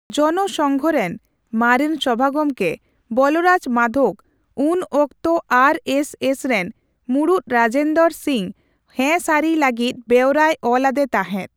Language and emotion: Santali, neutral